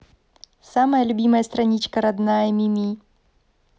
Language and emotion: Russian, positive